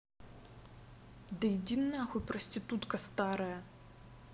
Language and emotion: Russian, angry